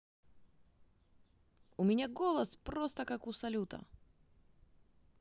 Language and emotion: Russian, positive